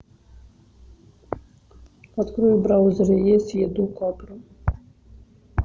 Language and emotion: Russian, neutral